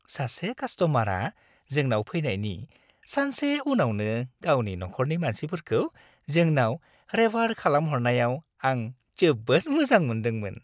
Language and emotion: Bodo, happy